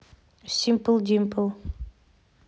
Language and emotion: Russian, neutral